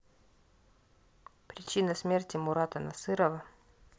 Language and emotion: Russian, neutral